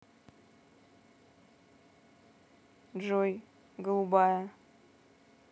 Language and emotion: Russian, neutral